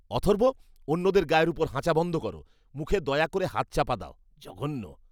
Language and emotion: Bengali, disgusted